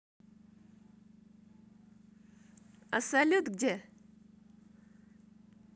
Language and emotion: Russian, positive